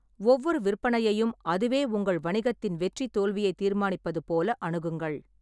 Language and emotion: Tamil, neutral